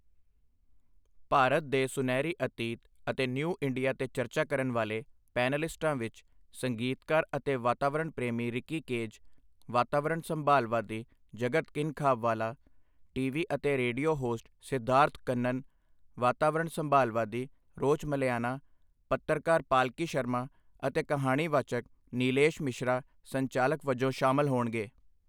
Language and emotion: Punjabi, neutral